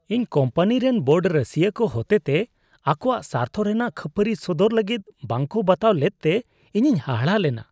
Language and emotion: Santali, disgusted